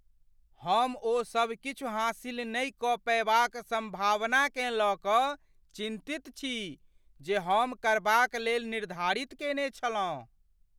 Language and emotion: Maithili, fearful